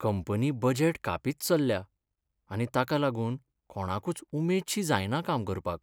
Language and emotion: Goan Konkani, sad